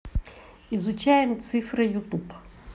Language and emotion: Russian, positive